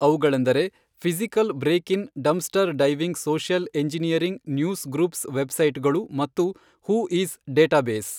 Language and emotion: Kannada, neutral